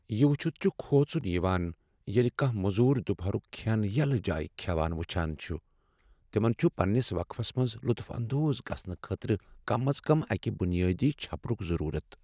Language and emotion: Kashmiri, sad